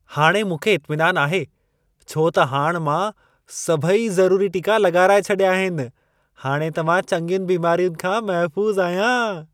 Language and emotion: Sindhi, happy